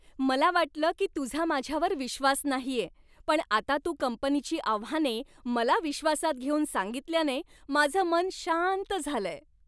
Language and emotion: Marathi, happy